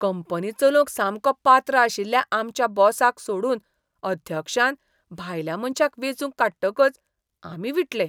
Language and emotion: Goan Konkani, disgusted